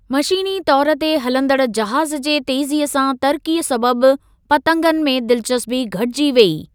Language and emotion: Sindhi, neutral